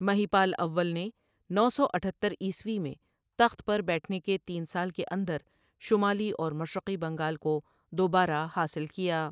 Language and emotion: Urdu, neutral